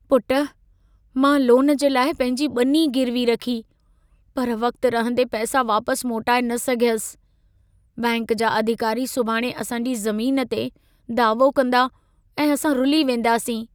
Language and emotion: Sindhi, sad